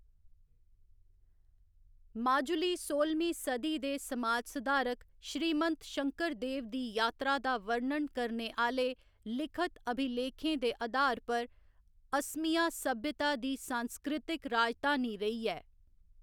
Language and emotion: Dogri, neutral